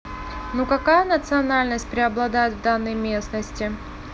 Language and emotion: Russian, neutral